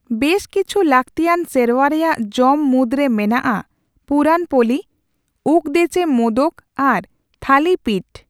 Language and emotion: Santali, neutral